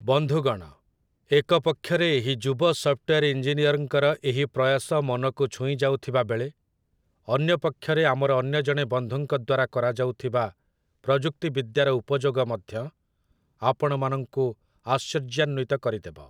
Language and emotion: Odia, neutral